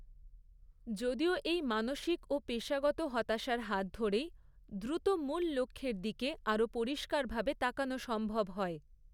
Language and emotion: Bengali, neutral